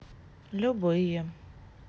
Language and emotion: Russian, sad